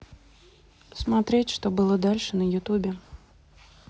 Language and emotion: Russian, neutral